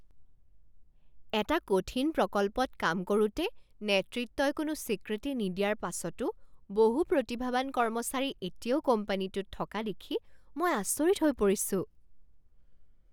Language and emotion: Assamese, surprised